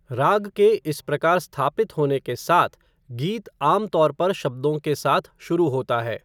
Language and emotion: Hindi, neutral